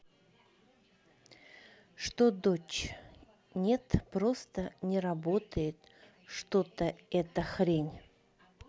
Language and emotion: Russian, neutral